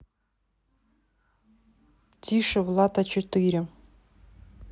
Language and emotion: Russian, neutral